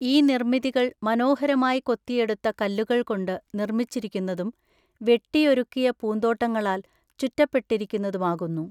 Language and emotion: Malayalam, neutral